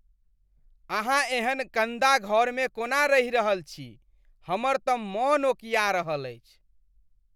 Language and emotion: Maithili, disgusted